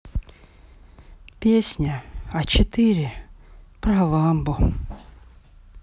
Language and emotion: Russian, sad